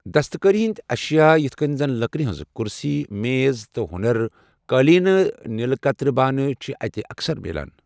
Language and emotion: Kashmiri, neutral